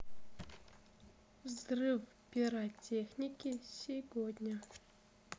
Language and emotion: Russian, neutral